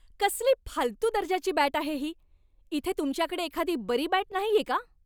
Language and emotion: Marathi, angry